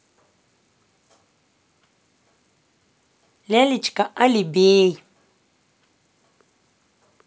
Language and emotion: Russian, positive